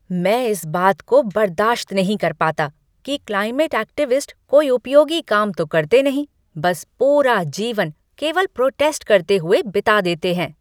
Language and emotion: Hindi, angry